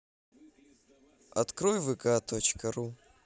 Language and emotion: Russian, neutral